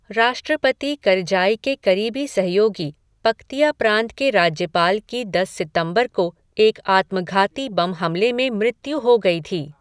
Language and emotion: Hindi, neutral